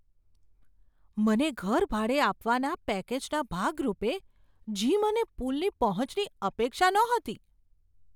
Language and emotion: Gujarati, surprised